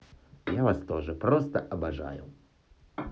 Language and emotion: Russian, positive